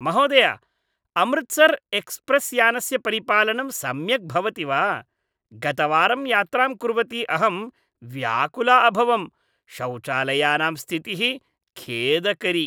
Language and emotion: Sanskrit, disgusted